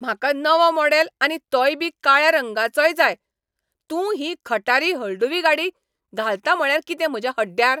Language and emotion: Goan Konkani, angry